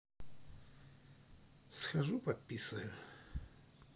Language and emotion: Russian, neutral